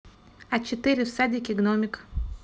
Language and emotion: Russian, neutral